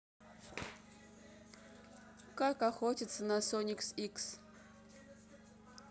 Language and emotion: Russian, neutral